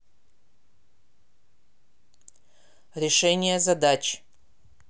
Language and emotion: Russian, neutral